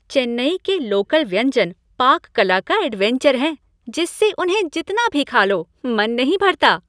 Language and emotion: Hindi, happy